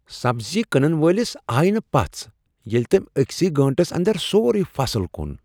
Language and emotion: Kashmiri, surprised